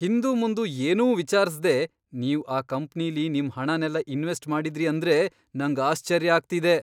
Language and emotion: Kannada, surprised